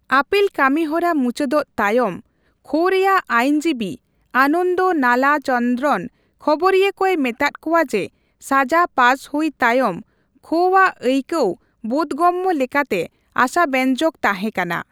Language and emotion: Santali, neutral